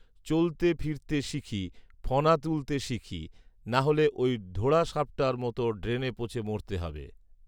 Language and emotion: Bengali, neutral